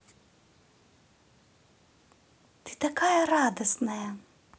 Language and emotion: Russian, positive